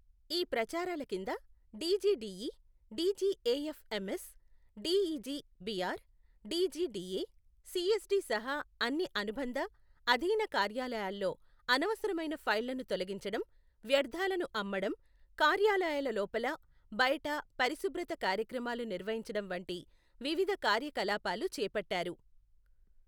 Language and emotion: Telugu, neutral